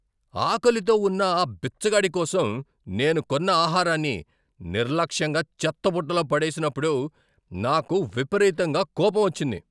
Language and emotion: Telugu, angry